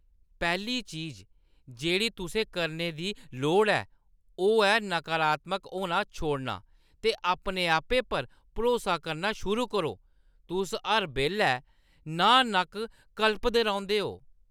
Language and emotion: Dogri, disgusted